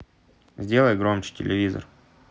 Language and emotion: Russian, neutral